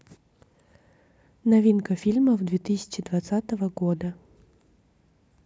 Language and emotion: Russian, neutral